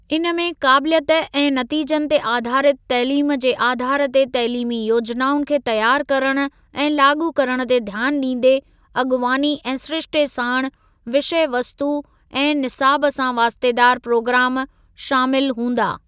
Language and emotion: Sindhi, neutral